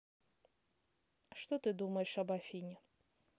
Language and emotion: Russian, neutral